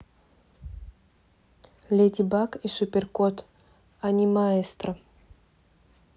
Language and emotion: Russian, neutral